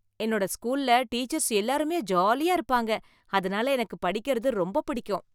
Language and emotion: Tamil, happy